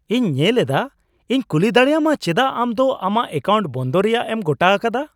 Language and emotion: Santali, surprised